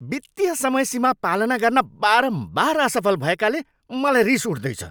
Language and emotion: Nepali, angry